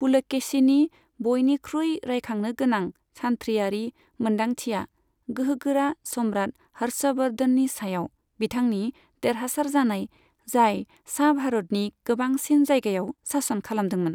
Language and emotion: Bodo, neutral